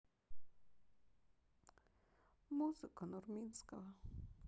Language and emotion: Russian, sad